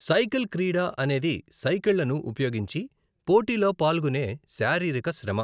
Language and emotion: Telugu, neutral